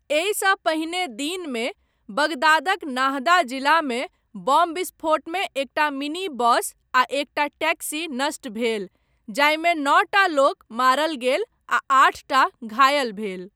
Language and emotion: Maithili, neutral